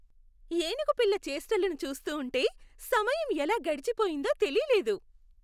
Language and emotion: Telugu, happy